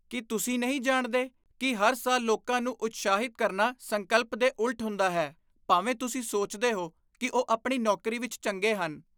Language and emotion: Punjabi, disgusted